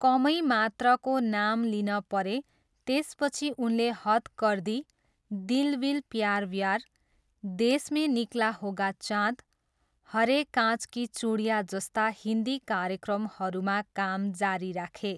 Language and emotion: Nepali, neutral